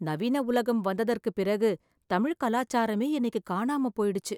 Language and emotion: Tamil, sad